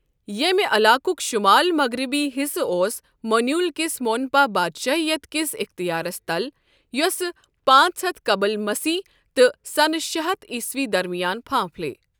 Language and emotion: Kashmiri, neutral